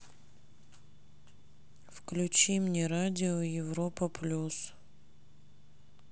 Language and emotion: Russian, sad